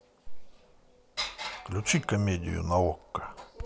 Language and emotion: Russian, neutral